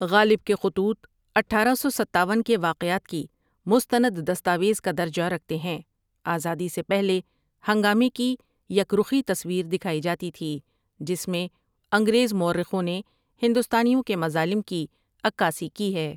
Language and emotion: Urdu, neutral